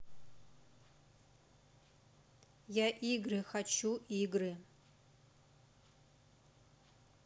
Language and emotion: Russian, neutral